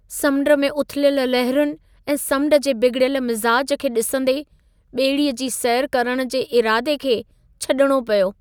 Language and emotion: Sindhi, sad